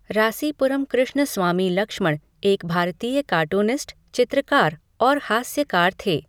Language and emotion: Hindi, neutral